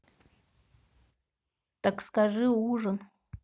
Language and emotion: Russian, neutral